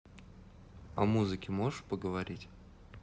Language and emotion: Russian, neutral